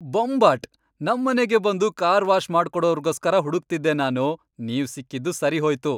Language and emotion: Kannada, happy